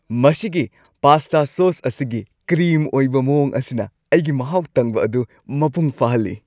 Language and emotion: Manipuri, happy